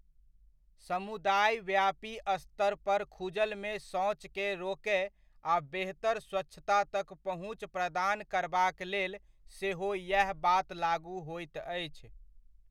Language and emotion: Maithili, neutral